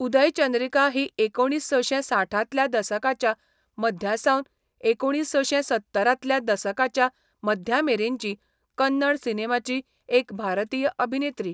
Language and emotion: Goan Konkani, neutral